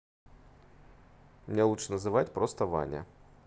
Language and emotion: Russian, neutral